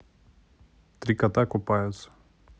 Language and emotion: Russian, neutral